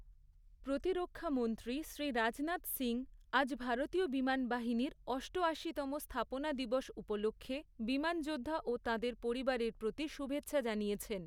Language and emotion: Bengali, neutral